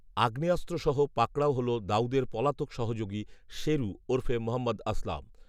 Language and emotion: Bengali, neutral